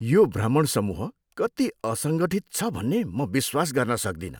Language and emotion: Nepali, disgusted